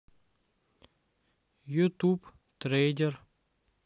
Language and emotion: Russian, neutral